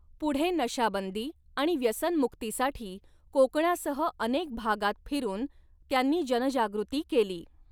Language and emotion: Marathi, neutral